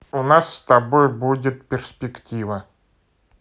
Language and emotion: Russian, neutral